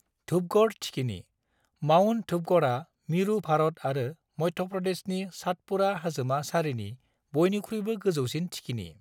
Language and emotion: Bodo, neutral